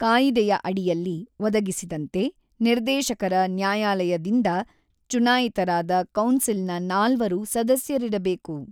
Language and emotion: Kannada, neutral